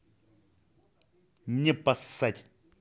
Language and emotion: Russian, angry